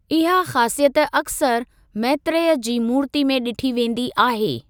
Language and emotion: Sindhi, neutral